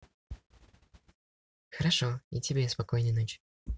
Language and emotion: Russian, positive